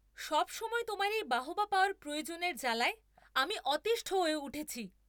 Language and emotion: Bengali, angry